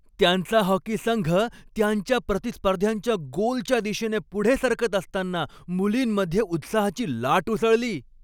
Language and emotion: Marathi, happy